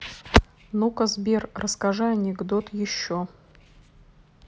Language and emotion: Russian, neutral